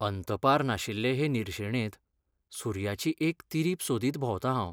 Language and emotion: Goan Konkani, sad